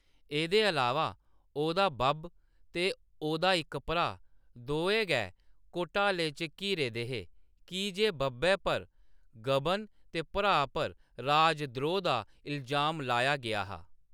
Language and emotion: Dogri, neutral